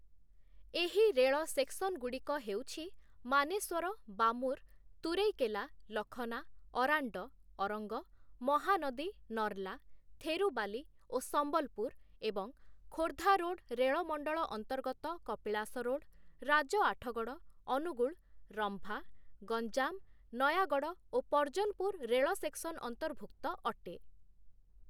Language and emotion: Odia, neutral